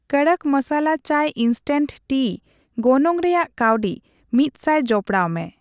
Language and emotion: Santali, neutral